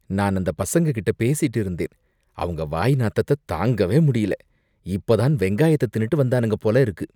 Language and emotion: Tamil, disgusted